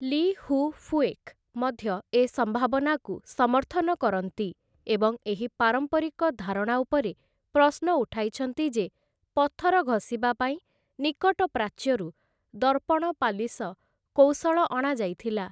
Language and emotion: Odia, neutral